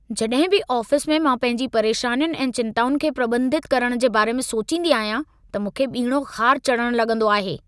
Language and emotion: Sindhi, angry